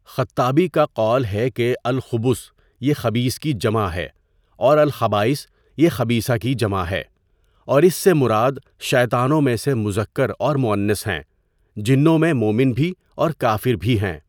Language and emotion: Urdu, neutral